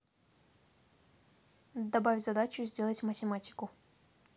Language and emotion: Russian, neutral